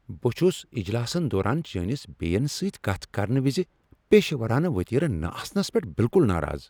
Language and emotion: Kashmiri, angry